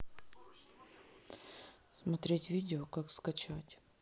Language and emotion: Russian, neutral